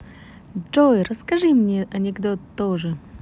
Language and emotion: Russian, positive